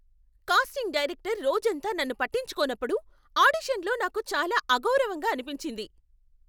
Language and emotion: Telugu, angry